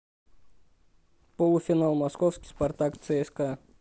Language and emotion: Russian, neutral